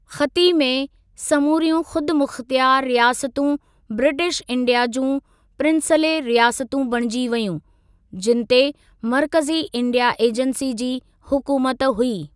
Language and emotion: Sindhi, neutral